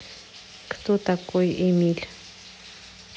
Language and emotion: Russian, neutral